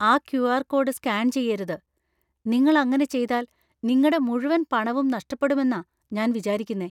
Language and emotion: Malayalam, fearful